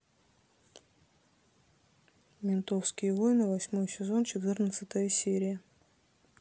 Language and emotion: Russian, neutral